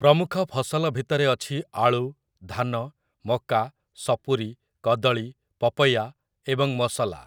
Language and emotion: Odia, neutral